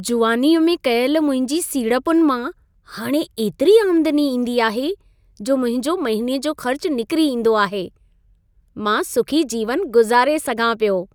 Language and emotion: Sindhi, happy